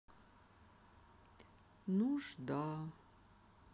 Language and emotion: Russian, sad